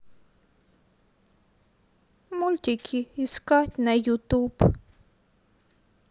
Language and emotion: Russian, sad